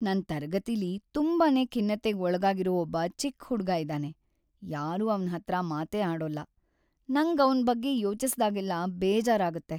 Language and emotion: Kannada, sad